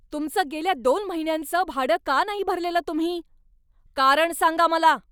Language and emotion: Marathi, angry